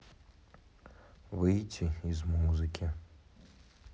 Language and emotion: Russian, sad